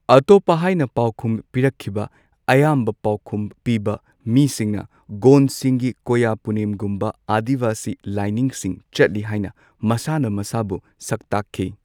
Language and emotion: Manipuri, neutral